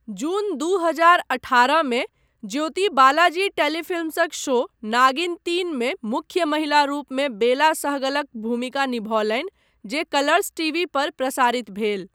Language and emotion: Maithili, neutral